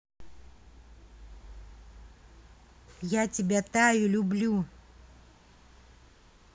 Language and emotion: Russian, neutral